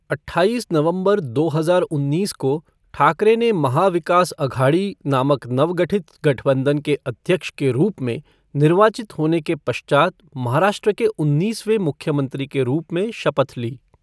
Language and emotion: Hindi, neutral